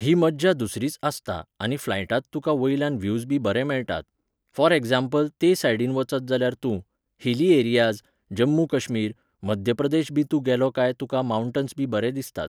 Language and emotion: Goan Konkani, neutral